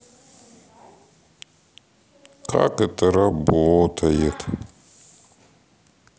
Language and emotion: Russian, sad